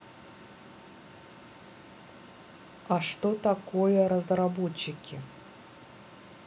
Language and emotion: Russian, neutral